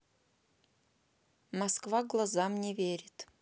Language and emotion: Russian, neutral